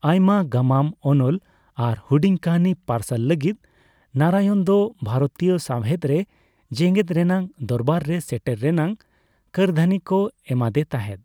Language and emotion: Santali, neutral